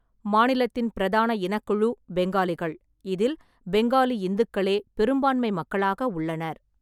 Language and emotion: Tamil, neutral